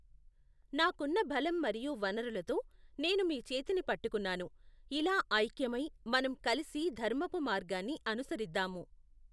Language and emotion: Telugu, neutral